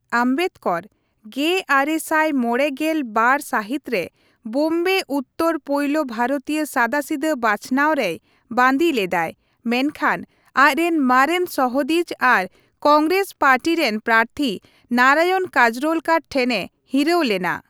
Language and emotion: Santali, neutral